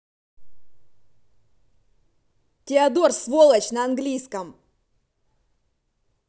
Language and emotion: Russian, angry